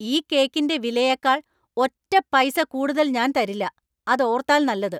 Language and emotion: Malayalam, angry